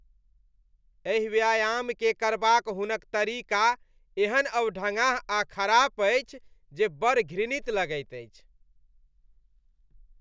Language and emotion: Maithili, disgusted